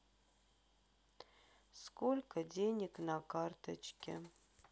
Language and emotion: Russian, sad